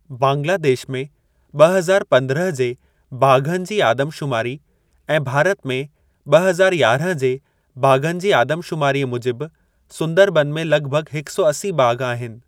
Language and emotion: Sindhi, neutral